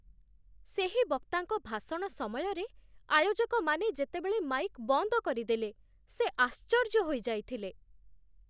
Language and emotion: Odia, surprised